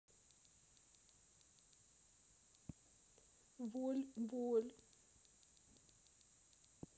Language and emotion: Russian, sad